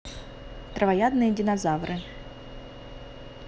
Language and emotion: Russian, neutral